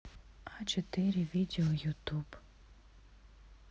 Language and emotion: Russian, neutral